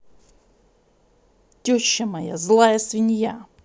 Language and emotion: Russian, angry